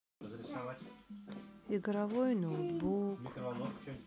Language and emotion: Russian, sad